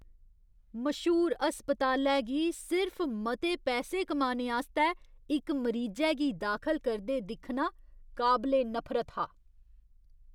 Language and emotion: Dogri, disgusted